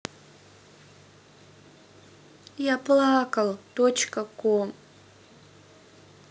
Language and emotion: Russian, sad